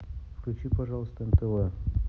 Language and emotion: Russian, neutral